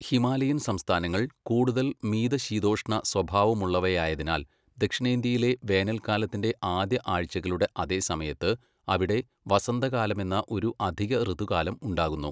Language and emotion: Malayalam, neutral